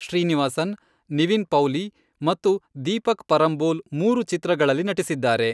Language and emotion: Kannada, neutral